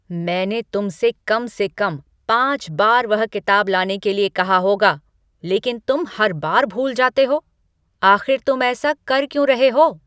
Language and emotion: Hindi, angry